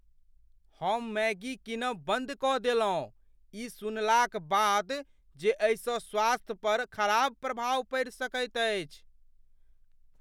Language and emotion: Maithili, fearful